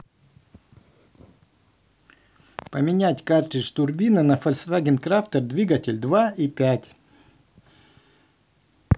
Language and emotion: Russian, neutral